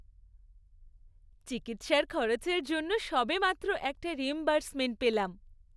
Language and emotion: Bengali, happy